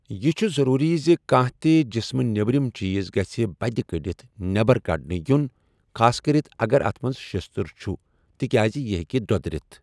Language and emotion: Kashmiri, neutral